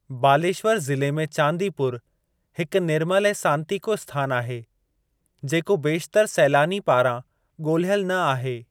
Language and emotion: Sindhi, neutral